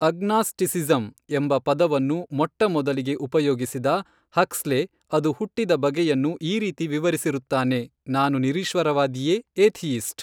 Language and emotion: Kannada, neutral